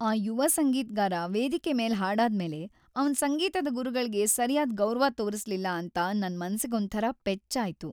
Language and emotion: Kannada, sad